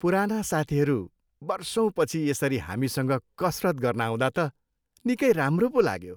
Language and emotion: Nepali, happy